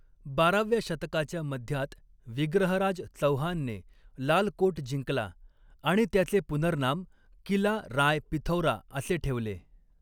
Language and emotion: Marathi, neutral